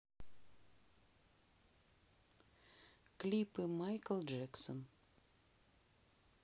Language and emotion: Russian, neutral